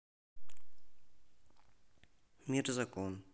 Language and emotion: Russian, neutral